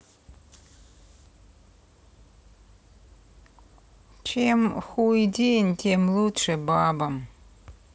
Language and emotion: Russian, neutral